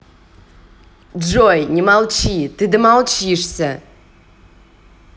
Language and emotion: Russian, angry